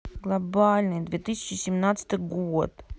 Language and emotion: Russian, sad